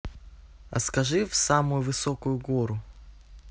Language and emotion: Russian, neutral